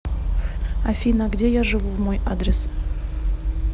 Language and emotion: Russian, neutral